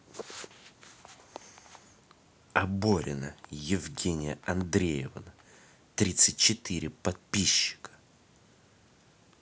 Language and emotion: Russian, angry